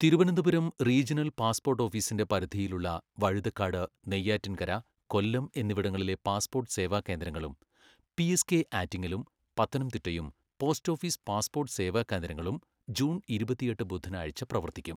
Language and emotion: Malayalam, neutral